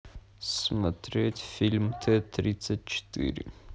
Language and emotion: Russian, neutral